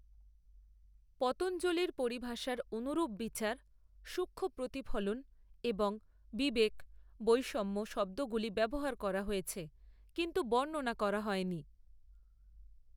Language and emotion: Bengali, neutral